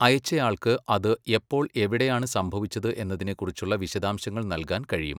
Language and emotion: Malayalam, neutral